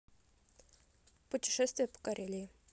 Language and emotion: Russian, neutral